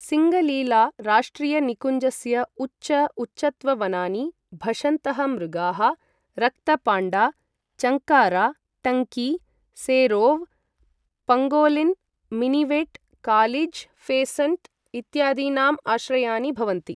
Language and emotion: Sanskrit, neutral